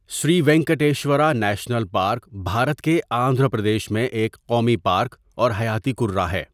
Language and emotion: Urdu, neutral